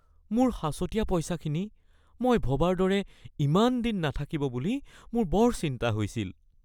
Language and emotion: Assamese, fearful